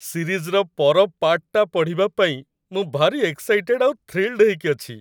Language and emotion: Odia, happy